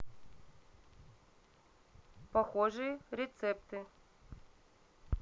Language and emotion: Russian, neutral